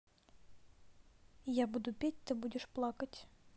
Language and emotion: Russian, neutral